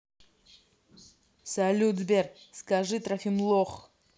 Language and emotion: Russian, neutral